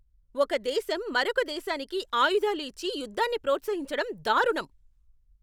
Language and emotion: Telugu, angry